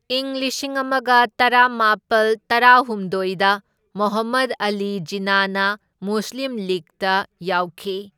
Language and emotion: Manipuri, neutral